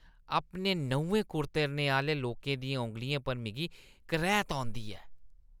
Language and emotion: Dogri, disgusted